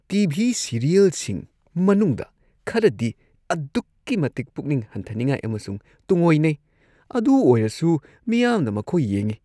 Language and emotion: Manipuri, disgusted